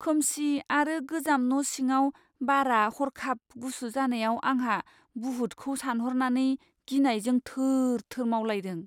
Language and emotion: Bodo, fearful